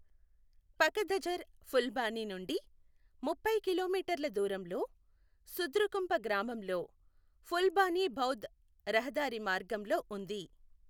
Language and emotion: Telugu, neutral